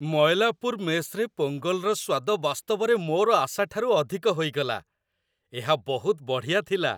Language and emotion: Odia, happy